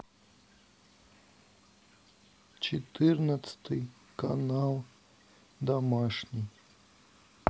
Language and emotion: Russian, sad